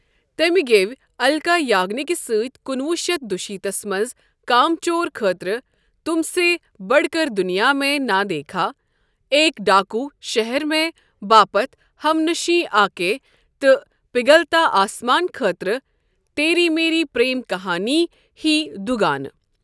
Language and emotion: Kashmiri, neutral